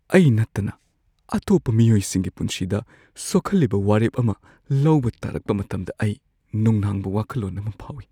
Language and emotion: Manipuri, fearful